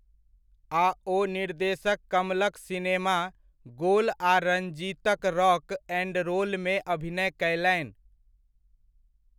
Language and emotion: Maithili, neutral